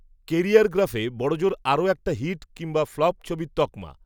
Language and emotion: Bengali, neutral